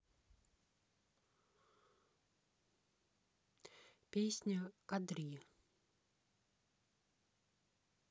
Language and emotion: Russian, neutral